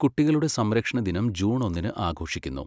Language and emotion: Malayalam, neutral